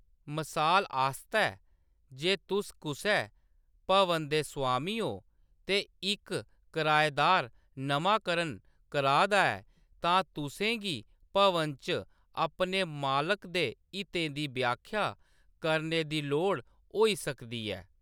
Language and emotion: Dogri, neutral